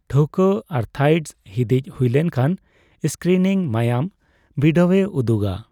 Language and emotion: Santali, neutral